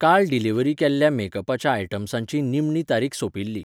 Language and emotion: Goan Konkani, neutral